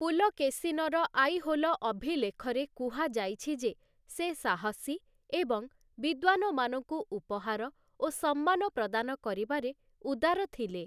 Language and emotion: Odia, neutral